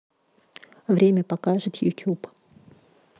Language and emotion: Russian, neutral